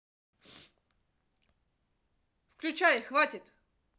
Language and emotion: Russian, angry